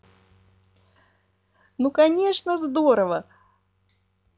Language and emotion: Russian, positive